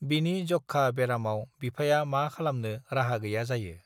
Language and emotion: Bodo, neutral